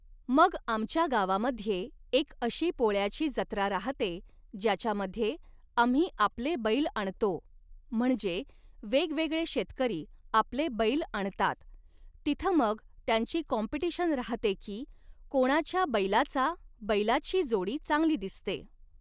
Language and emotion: Marathi, neutral